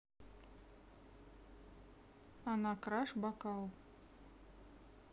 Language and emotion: Russian, neutral